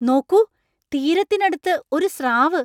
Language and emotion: Malayalam, surprised